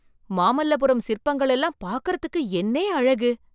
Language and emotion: Tamil, surprised